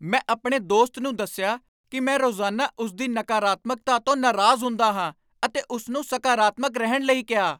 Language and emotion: Punjabi, angry